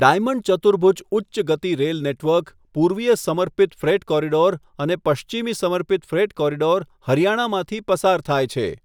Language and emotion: Gujarati, neutral